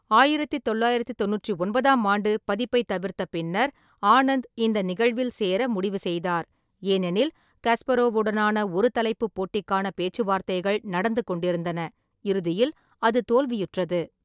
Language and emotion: Tamil, neutral